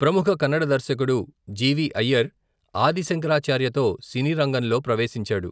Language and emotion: Telugu, neutral